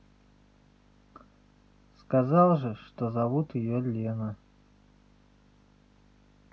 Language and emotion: Russian, neutral